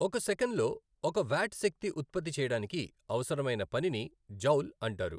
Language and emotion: Telugu, neutral